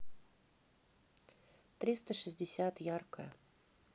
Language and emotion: Russian, neutral